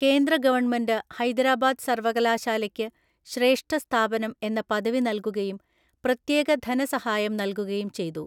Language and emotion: Malayalam, neutral